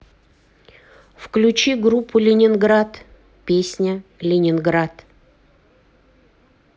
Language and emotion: Russian, neutral